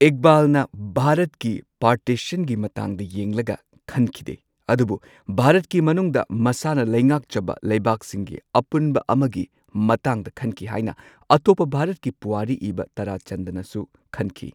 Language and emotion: Manipuri, neutral